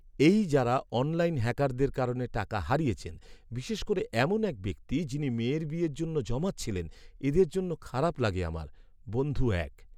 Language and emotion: Bengali, sad